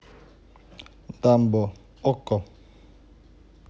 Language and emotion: Russian, neutral